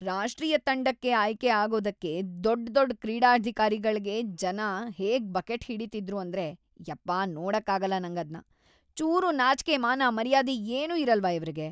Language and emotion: Kannada, disgusted